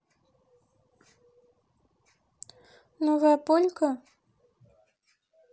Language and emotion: Russian, neutral